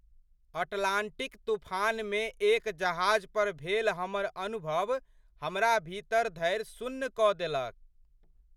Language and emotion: Maithili, surprised